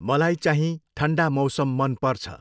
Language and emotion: Nepali, neutral